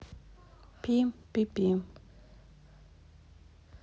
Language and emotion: Russian, neutral